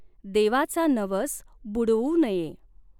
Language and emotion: Marathi, neutral